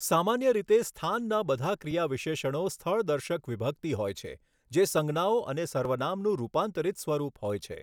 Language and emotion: Gujarati, neutral